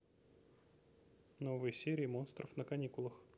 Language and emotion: Russian, neutral